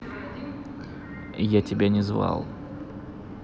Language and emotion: Russian, angry